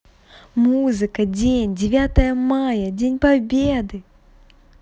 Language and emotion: Russian, positive